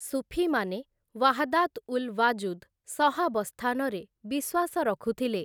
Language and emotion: Odia, neutral